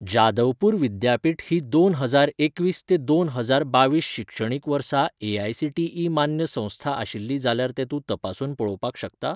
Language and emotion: Goan Konkani, neutral